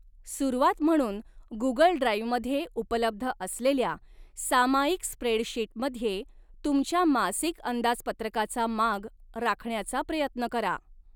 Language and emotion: Marathi, neutral